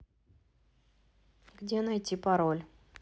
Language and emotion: Russian, neutral